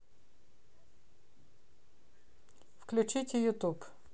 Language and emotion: Russian, neutral